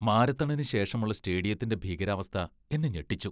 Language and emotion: Malayalam, disgusted